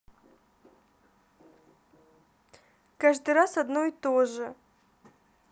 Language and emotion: Russian, sad